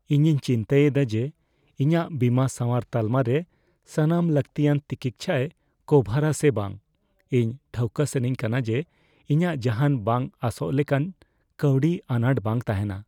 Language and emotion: Santali, fearful